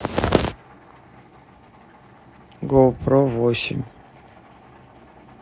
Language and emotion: Russian, neutral